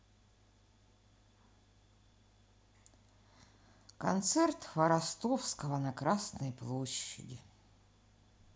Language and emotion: Russian, sad